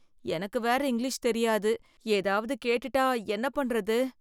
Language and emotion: Tamil, fearful